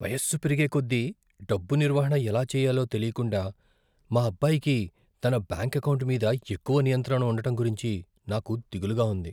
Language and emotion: Telugu, fearful